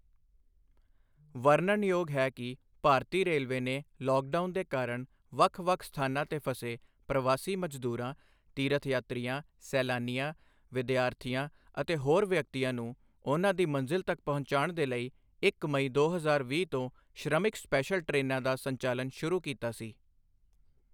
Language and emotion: Punjabi, neutral